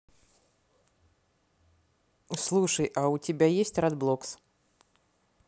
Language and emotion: Russian, neutral